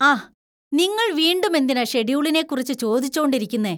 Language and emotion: Malayalam, disgusted